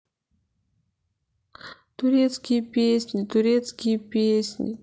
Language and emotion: Russian, sad